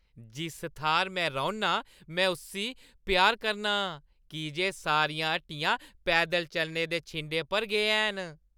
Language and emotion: Dogri, happy